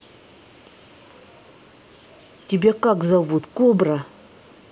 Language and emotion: Russian, angry